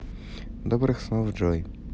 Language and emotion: Russian, positive